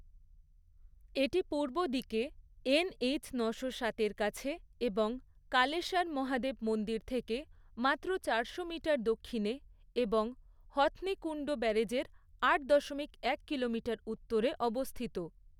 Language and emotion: Bengali, neutral